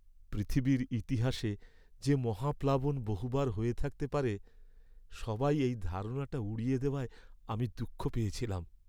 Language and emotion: Bengali, sad